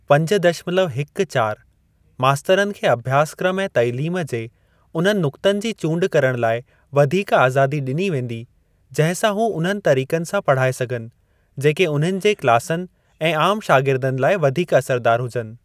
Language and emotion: Sindhi, neutral